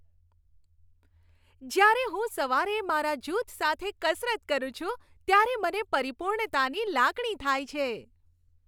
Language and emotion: Gujarati, happy